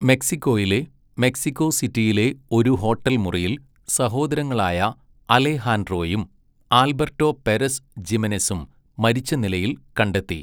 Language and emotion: Malayalam, neutral